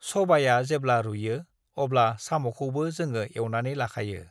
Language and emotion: Bodo, neutral